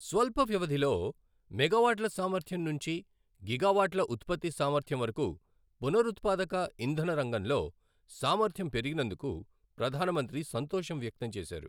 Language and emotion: Telugu, neutral